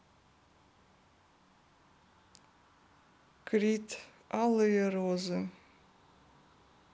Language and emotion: Russian, neutral